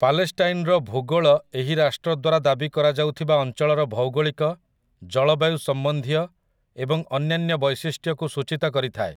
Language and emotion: Odia, neutral